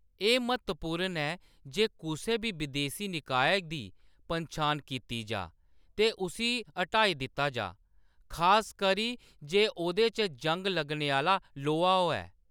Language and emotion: Dogri, neutral